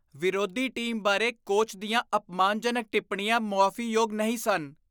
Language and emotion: Punjabi, disgusted